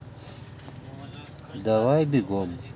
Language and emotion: Russian, neutral